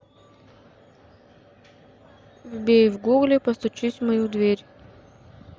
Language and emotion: Russian, neutral